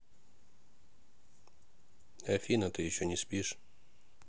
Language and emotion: Russian, neutral